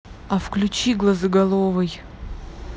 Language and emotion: Russian, neutral